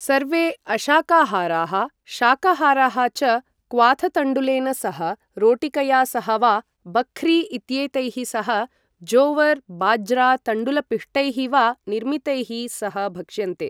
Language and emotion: Sanskrit, neutral